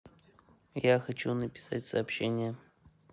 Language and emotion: Russian, neutral